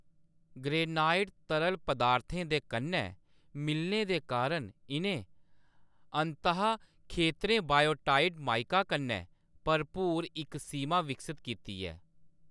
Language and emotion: Dogri, neutral